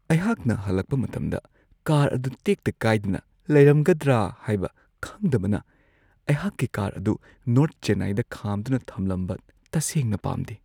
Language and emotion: Manipuri, fearful